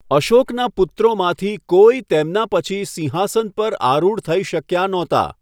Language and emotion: Gujarati, neutral